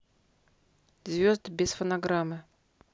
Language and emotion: Russian, neutral